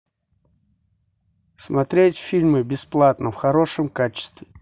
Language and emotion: Russian, neutral